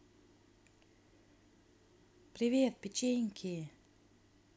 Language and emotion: Russian, positive